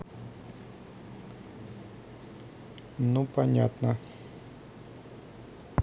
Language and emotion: Russian, neutral